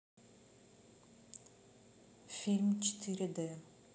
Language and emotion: Russian, neutral